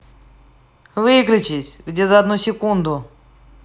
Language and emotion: Russian, angry